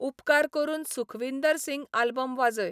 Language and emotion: Goan Konkani, neutral